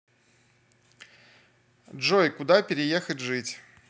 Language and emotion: Russian, neutral